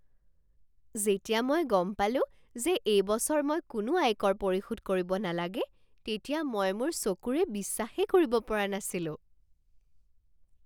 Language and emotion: Assamese, surprised